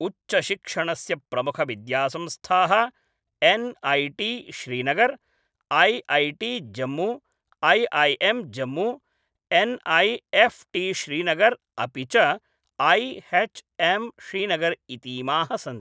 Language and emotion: Sanskrit, neutral